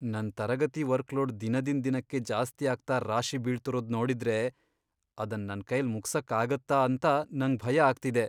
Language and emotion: Kannada, fearful